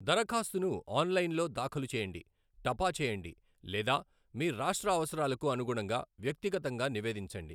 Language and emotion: Telugu, neutral